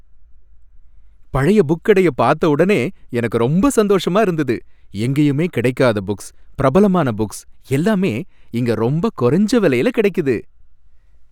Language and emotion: Tamil, happy